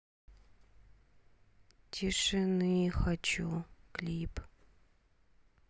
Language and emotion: Russian, sad